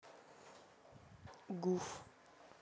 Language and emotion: Russian, neutral